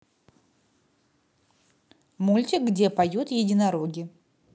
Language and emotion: Russian, neutral